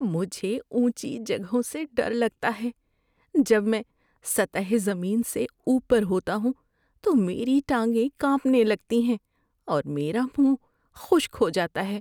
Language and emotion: Urdu, fearful